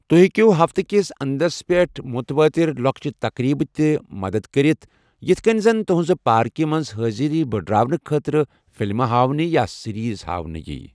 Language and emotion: Kashmiri, neutral